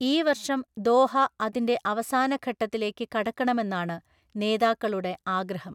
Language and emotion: Malayalam, neutral